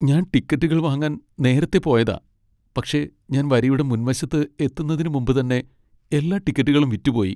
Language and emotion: Malayalam, sad